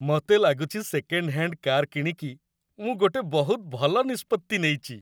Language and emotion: Odia, happy